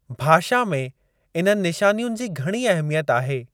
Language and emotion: Sindhi, neutral